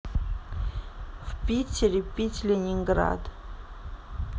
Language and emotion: Russian, neutral